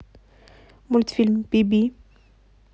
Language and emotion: Russian, neutral